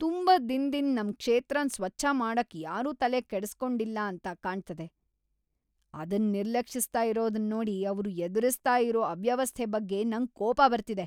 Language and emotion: Kannada, angry